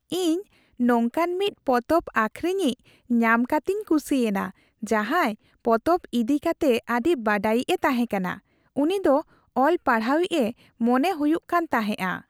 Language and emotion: Santali, happy